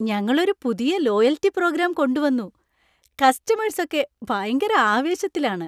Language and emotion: Malayalam, happy